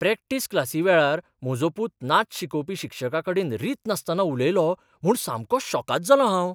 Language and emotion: Goan Konkani, surprised